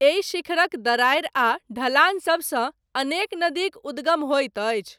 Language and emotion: Maithili, neutral